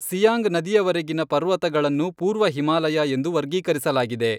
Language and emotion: Kannada, neutral